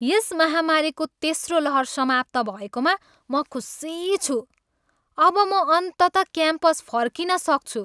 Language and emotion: Nepali, happy